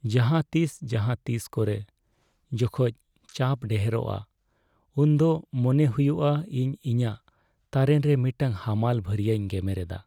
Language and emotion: Santali, sad